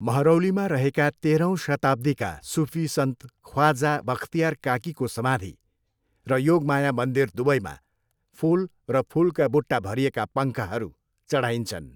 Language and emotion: Nepali, neutral